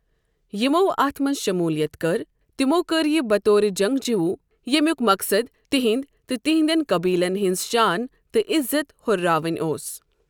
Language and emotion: Kashmiri, neutral